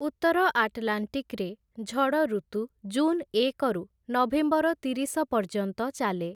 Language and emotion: Odia, neutral